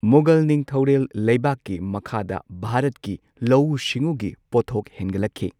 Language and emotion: Manipuri, neutral